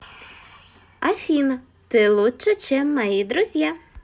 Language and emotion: Russian, positive